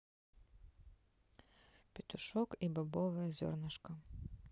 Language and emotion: Russian, neutral